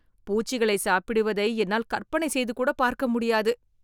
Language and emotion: Tamil, disgusted